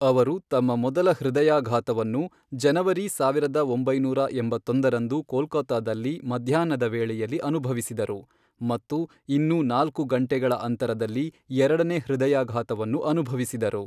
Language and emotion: Kannada, neutral